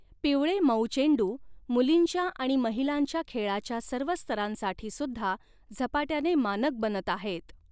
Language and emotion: Marathi, neutral